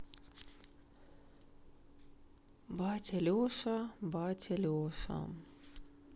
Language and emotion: Russian, sad